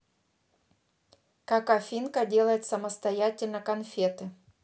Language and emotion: Russian, neutral